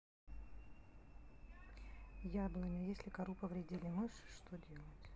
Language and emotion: Russian, neutral